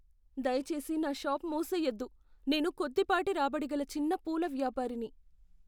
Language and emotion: Telugu, fearful